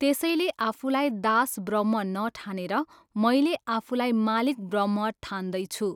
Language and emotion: Nepali, neutral